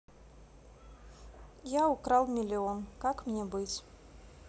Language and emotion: Russian, neutral